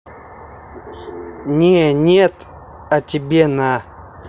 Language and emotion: Russian, neutral